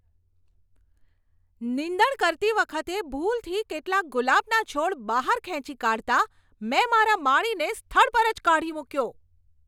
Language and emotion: Gujarati, angry